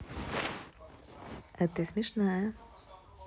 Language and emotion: Russian, positive